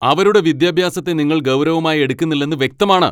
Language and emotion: Malayalam, angry